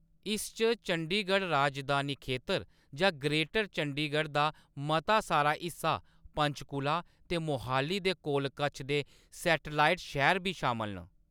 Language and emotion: Dogri, neutral